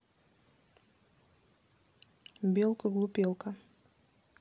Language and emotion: Russian, neutral